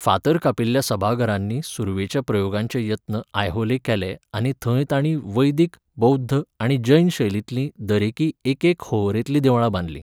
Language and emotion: Goan Konkani, neutral